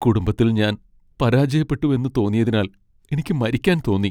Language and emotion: Malayalam, sad